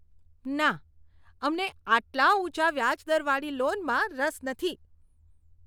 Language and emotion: Gujarati, disgusted